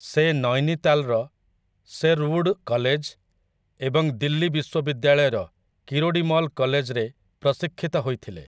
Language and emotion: Odia, neutral